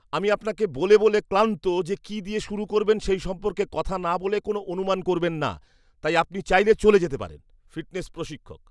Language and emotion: Bengali, disgusted